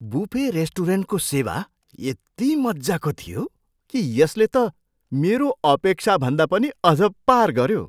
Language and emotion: Nepali, surprised